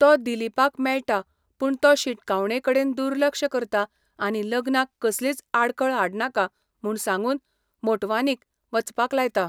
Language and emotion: Goan Konkani, neutral